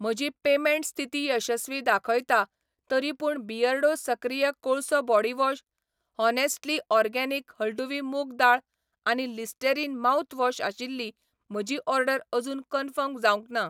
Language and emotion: Goan Konkani, neutral